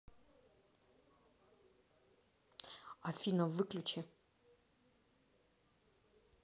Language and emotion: Russian, neutral